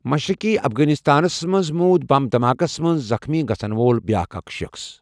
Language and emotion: Kashmiri, neutral